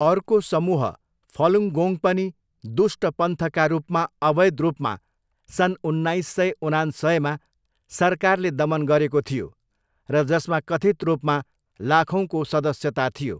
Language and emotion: Nepali, neutral